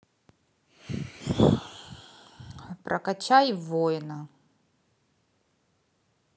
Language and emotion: Russian, neutral